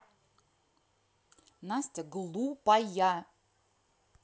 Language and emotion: Russian, angry